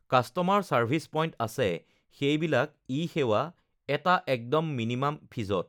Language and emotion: Assamese, neutral